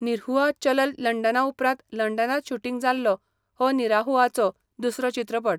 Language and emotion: Goan Konkani, neutral